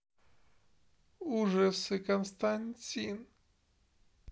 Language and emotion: Russian, sad